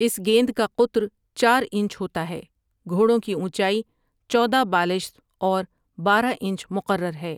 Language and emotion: Urdu, neutral